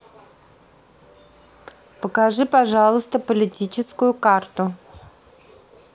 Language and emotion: Russian, neutral